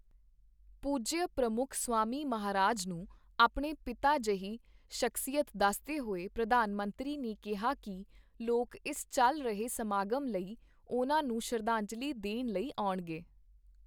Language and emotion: Punjabi, neutral